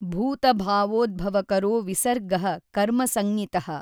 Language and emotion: Kannada, neutral